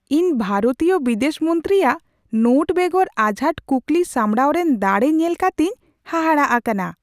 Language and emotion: Santali, surprised